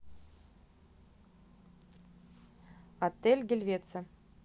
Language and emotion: Russian, neutral